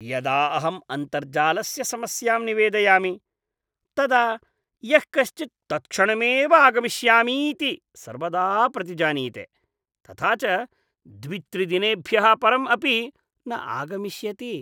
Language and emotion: Sanskrit, disgusted